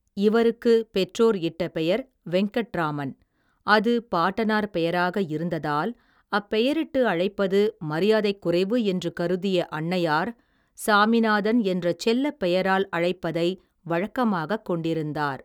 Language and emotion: Tamil, neutral